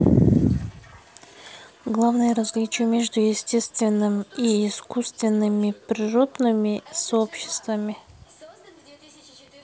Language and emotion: Russian, neutral